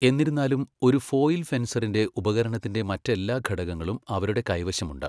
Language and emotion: Malayalam, neutral